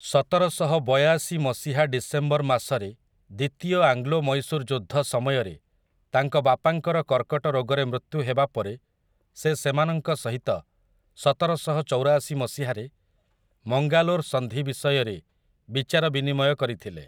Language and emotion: Odia, neutral